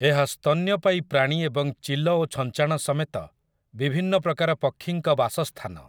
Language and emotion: Odia, neutral